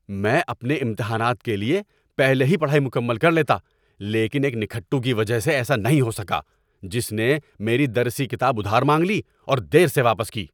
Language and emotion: Urdu, angry